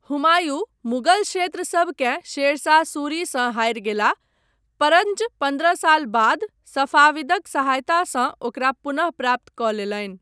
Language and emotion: Maithili, neutral